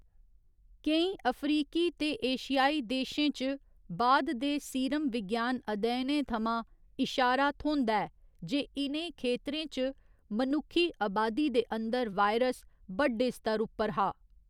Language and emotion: Dogri, neutral